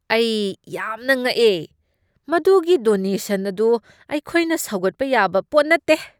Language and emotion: Manipuri, disgusted